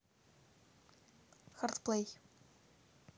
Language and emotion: Russian, neutral